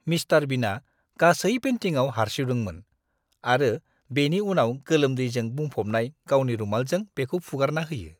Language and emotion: Bodo, disgusted